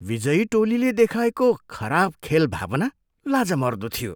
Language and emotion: Nepali, disgusted